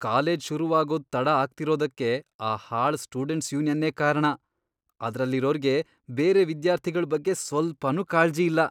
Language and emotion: Kannada, disgusted